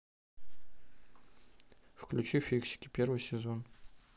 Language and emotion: Russian, neutral